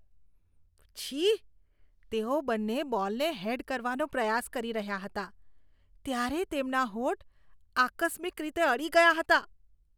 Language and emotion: Gujarati, disgusted